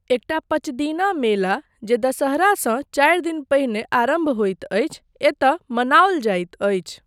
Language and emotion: Maithili, neutral